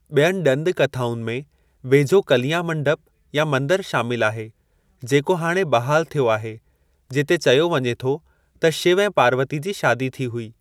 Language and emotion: Sindhi, neutral